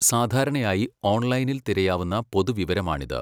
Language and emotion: Malayalam, neutral